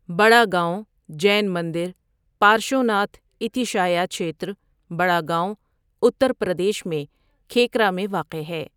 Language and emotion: Urdu, neutral